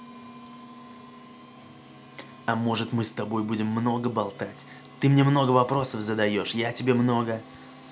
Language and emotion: Russian, positive